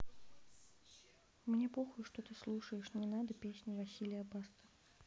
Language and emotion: Russian, neutral